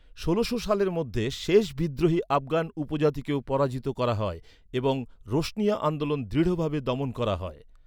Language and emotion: Bengali, neutral